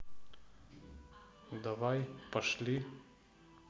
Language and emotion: Russian, neutral